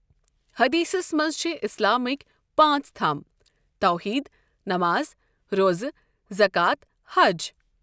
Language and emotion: Kashmiri, neutral